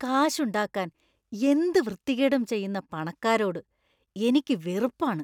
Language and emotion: Malayalam, disgusted